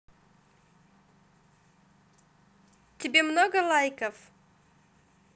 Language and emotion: Russian, positive